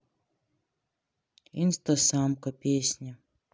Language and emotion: Russian, neutral